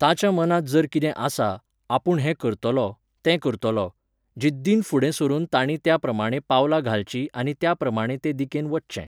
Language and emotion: Goan Konkani, neutral